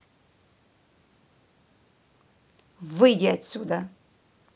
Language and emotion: Russian, angry